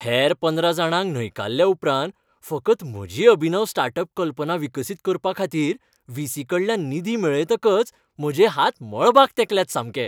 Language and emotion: Goan Konkani, happy